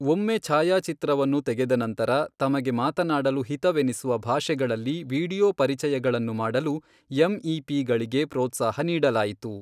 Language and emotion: Kannada, neutral